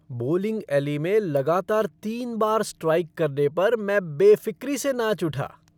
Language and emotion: Hindi, happy